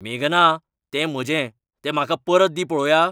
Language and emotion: Goan Konkani, angry